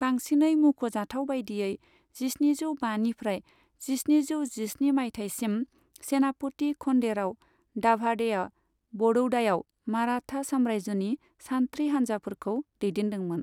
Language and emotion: Bodo, neutral